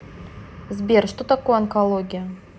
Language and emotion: Russian, neutral